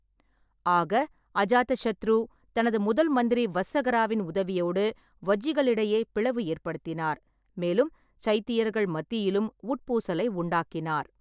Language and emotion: Tamil, neutral